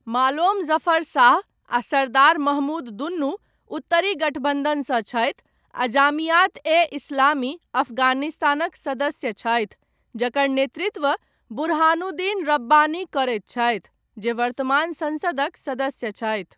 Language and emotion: Maithili, neutral